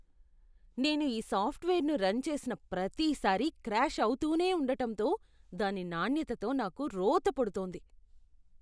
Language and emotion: Telugu, disgusted